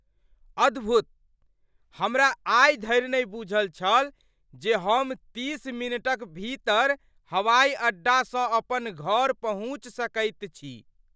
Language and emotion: Maithili, surprised